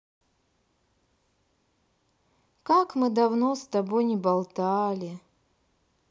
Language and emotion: Russian, sad